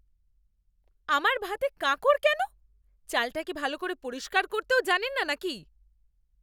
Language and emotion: Bengali, angry